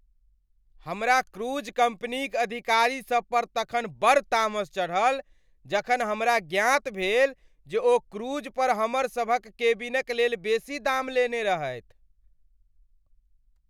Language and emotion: Maithili, angry